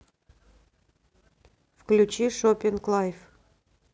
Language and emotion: Russian, neutral